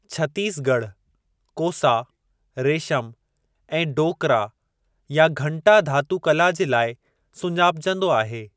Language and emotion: Sindhi, neutral